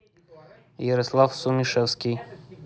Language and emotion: Russian, neutral